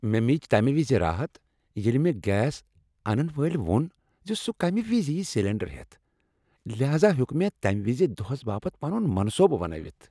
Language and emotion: Kashmiri, happy